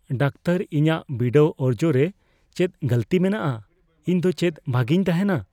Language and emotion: Santali, fearful